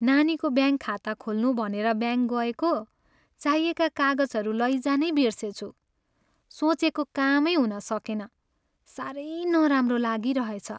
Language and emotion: Nepali, sad